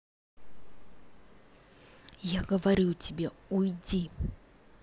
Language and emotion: Russian, angry